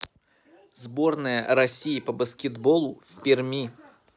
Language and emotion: Russian, neutral